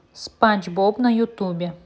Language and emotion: Russian, neutral